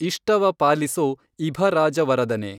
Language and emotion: Kannada, neutral